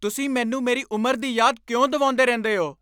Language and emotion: Punjabi, angry